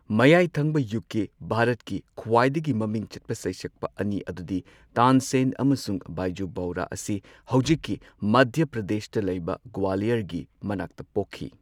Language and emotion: Manipuri, neutral